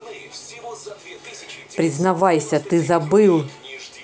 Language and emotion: Russian, angry